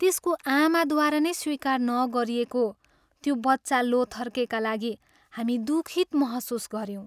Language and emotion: Nepali, sad